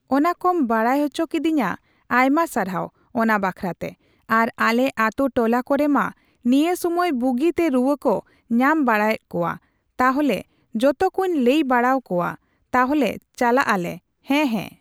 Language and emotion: Santali, neutral